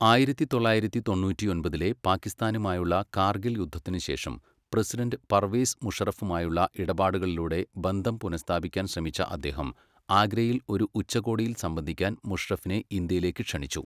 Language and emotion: Malayalam, neutral